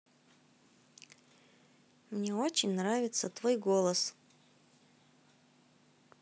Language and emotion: Russian, positive